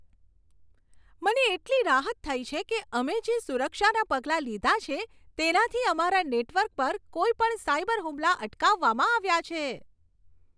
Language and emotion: Gujarati, happy